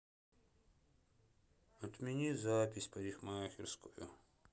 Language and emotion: Russian, sad